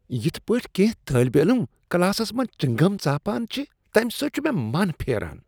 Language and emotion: Kashmiri, disgusted